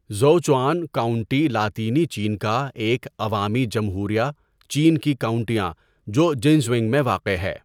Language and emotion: Urdu, neutral